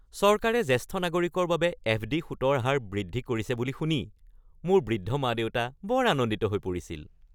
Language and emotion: Assamese, happy